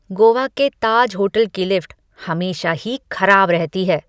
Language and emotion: Hindi, disgusted